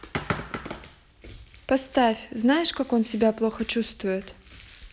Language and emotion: Russian, neutral